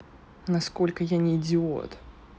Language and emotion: Russian, neutral